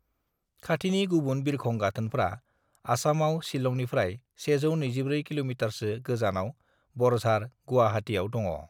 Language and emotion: Bodo, neutral